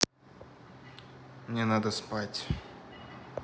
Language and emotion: Russian, neutral